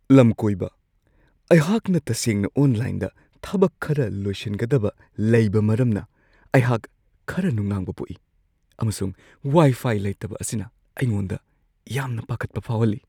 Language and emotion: Manipuri, fearful